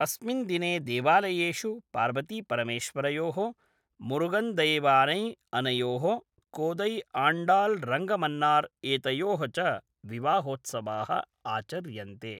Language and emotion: Sanskrit, neutral